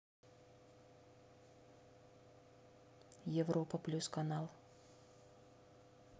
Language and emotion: Russian, neutral